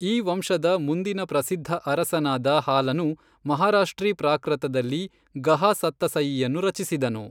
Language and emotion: Kannada, neutral